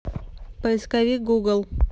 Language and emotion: Russian, neutral